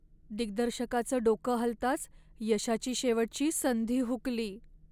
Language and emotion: Marathi, sad